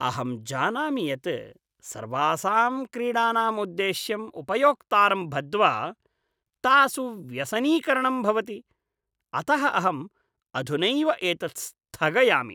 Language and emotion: Sanskrit, disgusted